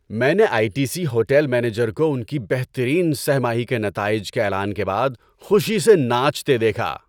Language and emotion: Urdu, happy